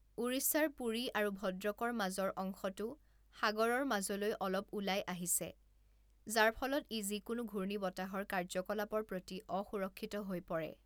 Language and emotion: Assamese, neutral